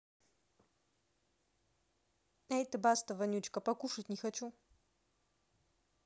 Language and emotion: Russian, neutral